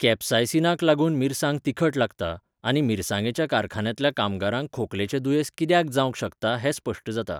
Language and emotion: Goan Konkani, neutral